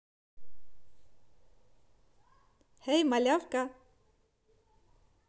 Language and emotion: Russian, positive